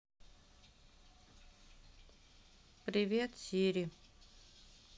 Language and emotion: Russian, sad